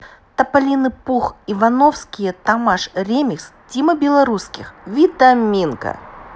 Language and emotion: Russian, neutral